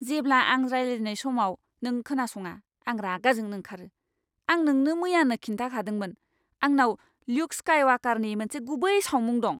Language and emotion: Bodo, angry